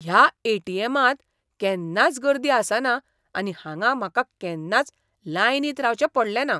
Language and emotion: Goan Konkani, surprised